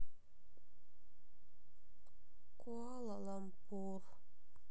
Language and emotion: Russian, sad